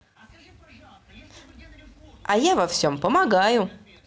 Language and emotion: Russian, positive